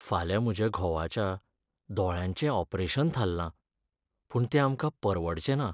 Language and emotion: Goan Konkani, sad